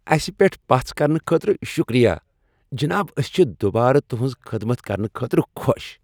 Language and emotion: Kashmiri, happy